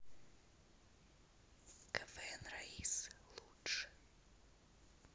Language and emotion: Russian, neutral